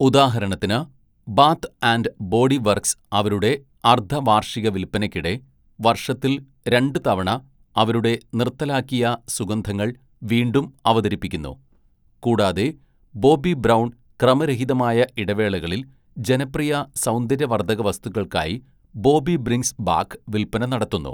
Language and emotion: Malayalam, neutral